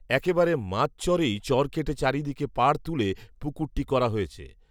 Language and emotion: Bengali, neutral